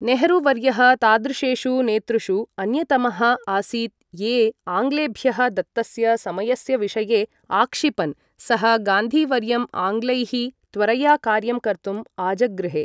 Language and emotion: Sanskrit, neutral